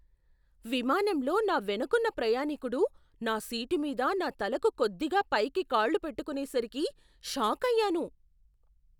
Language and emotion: Telugu, surprised